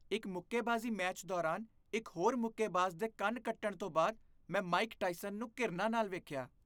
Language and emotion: Punjabi, disgusted